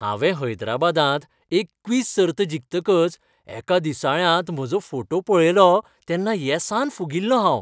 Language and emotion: Goan Konkani, happy